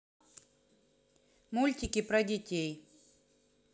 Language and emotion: Russian, neutral